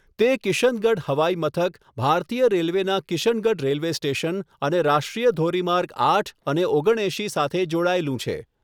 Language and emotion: Gujarati, neutral